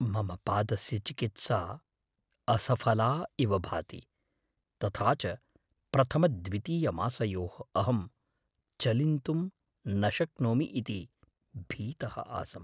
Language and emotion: Sanskrit, fearful